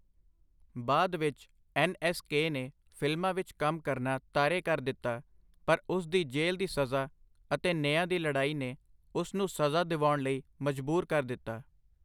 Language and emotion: Punjabi, neutral